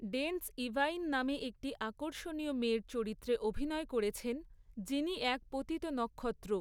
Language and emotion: Bengali, neutral